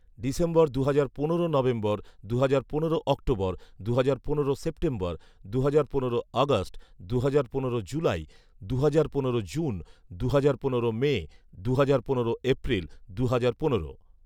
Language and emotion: Bengali, neutral